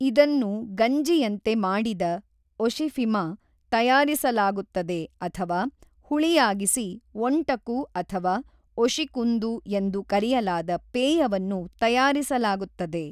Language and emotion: Kannada, neutral